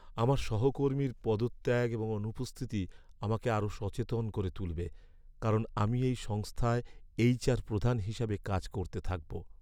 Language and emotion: Bengali, sad